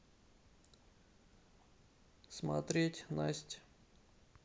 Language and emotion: Russian, sad